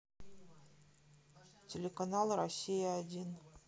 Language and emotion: Russian, neutral